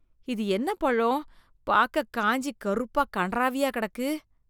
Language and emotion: Tamil, disgusted